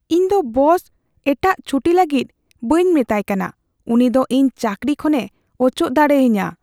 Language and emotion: Santali, fearful